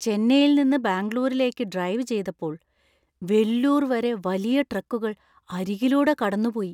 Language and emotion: Malayalam, fearful